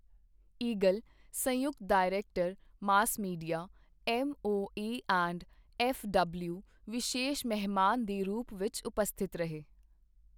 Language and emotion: Punjabi, neutral